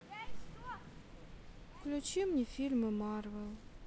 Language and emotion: Russian, sad